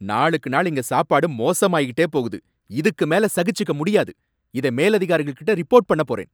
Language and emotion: Tamil, angry